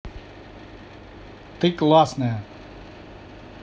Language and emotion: Russian, positive